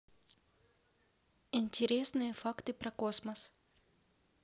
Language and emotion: Russian, neutral